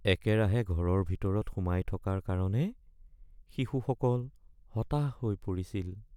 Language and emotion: Assamese, sad